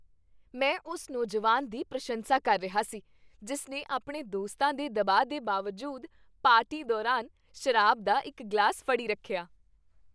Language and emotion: Punjabi, happy